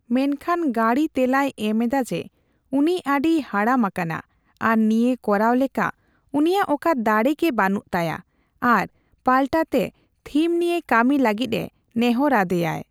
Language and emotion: Santali, neutral